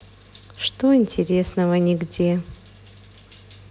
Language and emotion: Russian, neutral